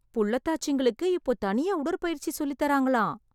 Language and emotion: Tamil, surprised